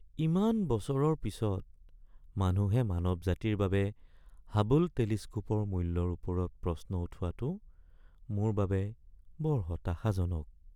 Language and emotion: Assamese, sad